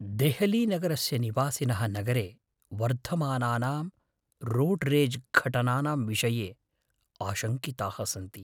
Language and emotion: Sanskrit, fearful